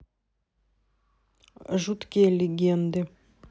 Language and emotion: Russian, neutral